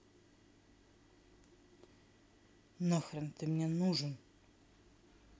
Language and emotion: Russian, angry